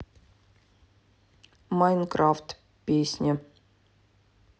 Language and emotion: Russian, neutral